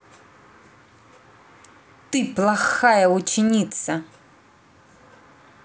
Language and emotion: Russian, angry